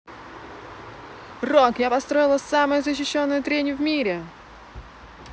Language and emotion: Russian, positive